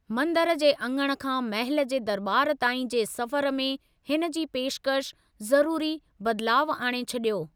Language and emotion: Sindhi, neutral